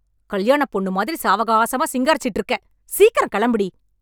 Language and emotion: Tamil, angry